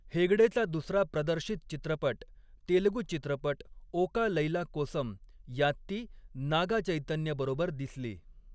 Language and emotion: Marathi, neutral